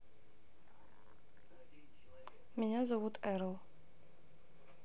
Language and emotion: Russian, neutral